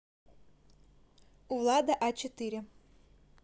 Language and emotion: Russian, neutral